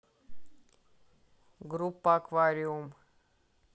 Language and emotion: Russian, neutral